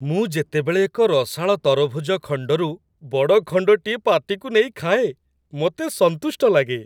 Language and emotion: Odia, happy